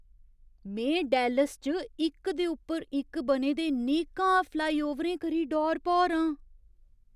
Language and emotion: Dogri, surprised